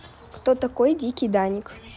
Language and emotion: Russian, neutral